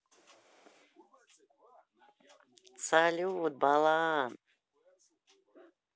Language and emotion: Russian, positive